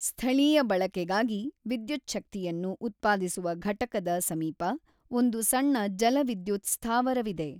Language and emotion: Kannada, neutral